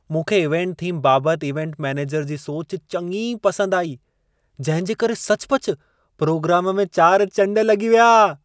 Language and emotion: Sindhi, happy